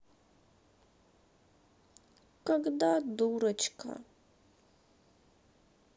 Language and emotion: Russian, sad